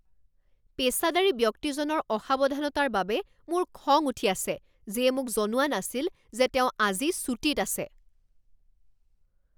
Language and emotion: Assamese, angry